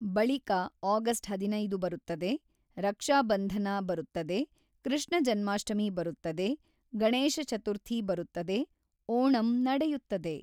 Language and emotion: Kannada, neutral